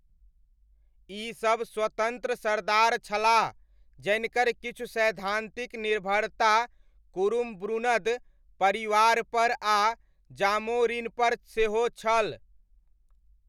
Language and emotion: Maithili, neutral